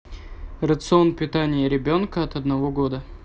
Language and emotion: Russian, neutral